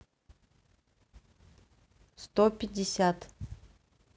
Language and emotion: Russian, neutral